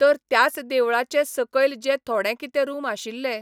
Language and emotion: Goan Konkani, neutral